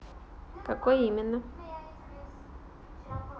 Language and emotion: Russian, neutral